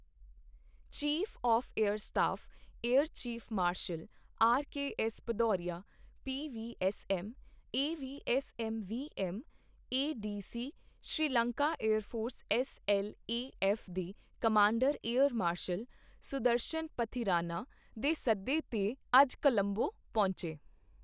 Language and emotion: Punjabi, neutral